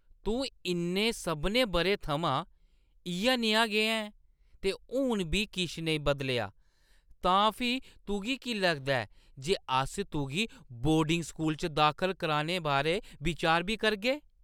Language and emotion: Dogri, surprised